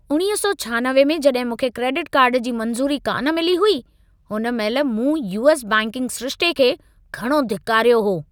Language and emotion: Sindhi, angry